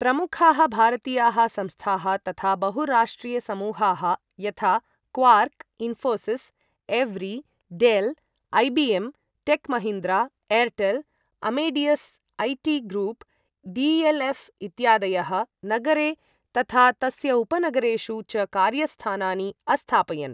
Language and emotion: Sanskrit, neutral